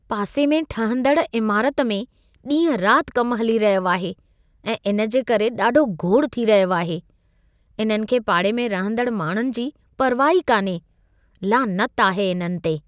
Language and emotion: Sindhi, disgusted